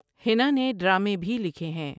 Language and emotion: Urdu, neutral